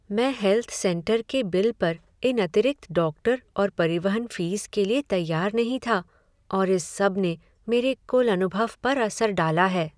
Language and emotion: Hindi, sad